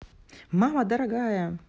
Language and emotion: Russian, positive